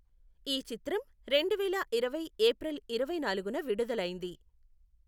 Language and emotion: Telugu, neutral